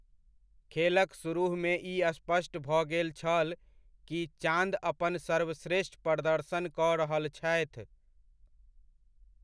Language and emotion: Maithili, neutral